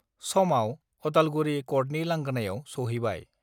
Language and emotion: Bodo, neutral